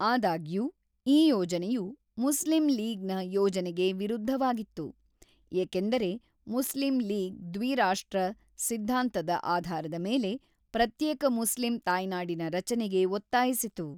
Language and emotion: Kannada, neutral